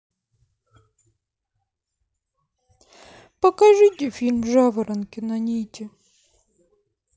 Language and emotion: Russian, sad